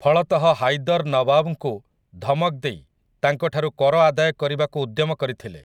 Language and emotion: Odia, neutral